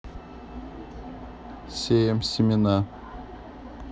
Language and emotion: Russian, neutral